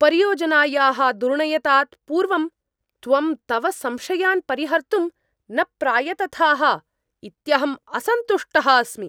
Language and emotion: Sanskrit, angry